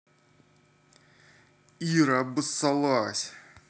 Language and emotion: Russian, neutral